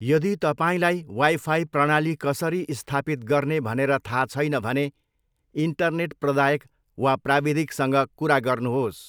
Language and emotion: Nepali, neutral